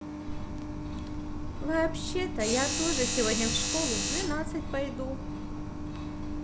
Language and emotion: Russian, positive